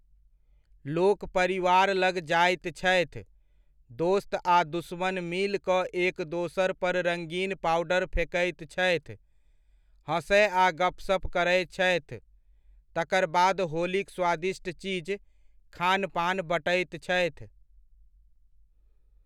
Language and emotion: Maithili, neutral